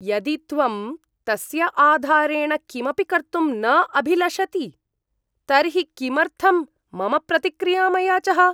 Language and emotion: Sanskrit, disgusted